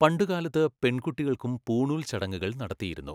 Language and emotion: Malayalam, neutral